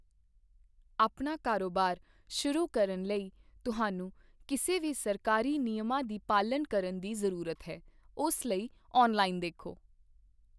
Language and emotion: Punjabi, neutral